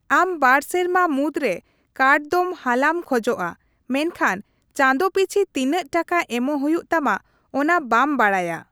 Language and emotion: Santali, neutral